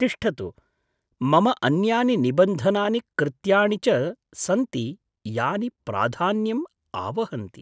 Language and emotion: Sanskrit, surprised